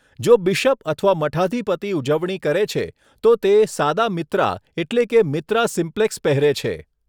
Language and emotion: Gujarati, neutral